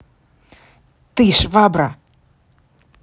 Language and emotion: Russian, angry